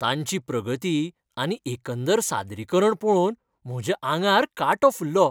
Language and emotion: Goan Konkani, happy